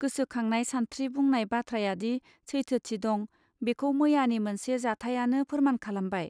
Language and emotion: Bodo, neutral